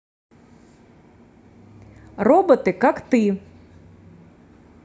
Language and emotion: Russian, positive